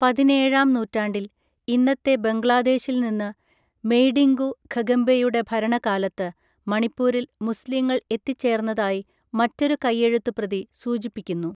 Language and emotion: Malayalam, neutral